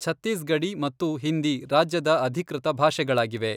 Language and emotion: Kannada, neutral